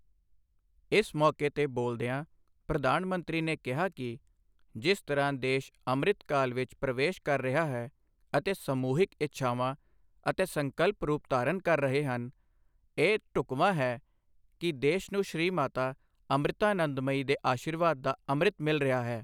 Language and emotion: Punjabi, neutral